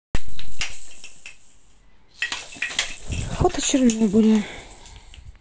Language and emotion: Russian, neutral